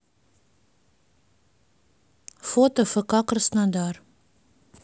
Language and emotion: Russian, neutral